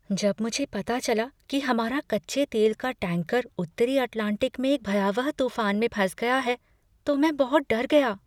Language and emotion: Hindi, fearful